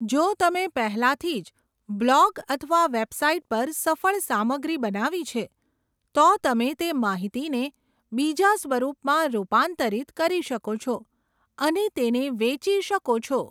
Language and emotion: Gujarati, neutral